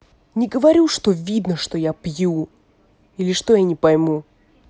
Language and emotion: Russian, angry